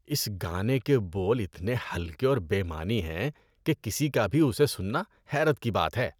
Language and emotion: Urdu, disgusted